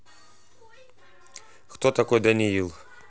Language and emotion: Russian, neutral